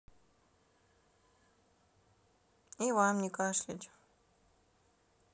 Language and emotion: Russian, neutral